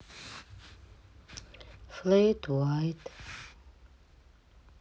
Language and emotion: Russian, sad